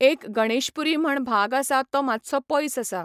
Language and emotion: Goan Konkani, neutral